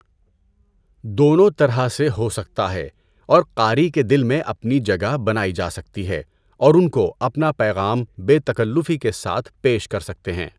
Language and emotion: Urdu, neutral